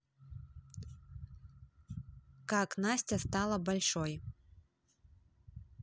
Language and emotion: Russian, neutral